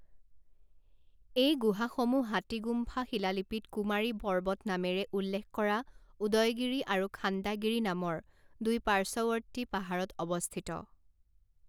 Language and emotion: Assamese, neutral